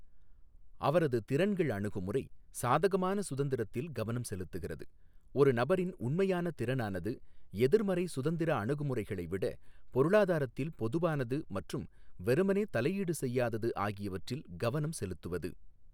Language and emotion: Tamil, neutral